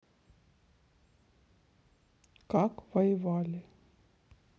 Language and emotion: Russian, sad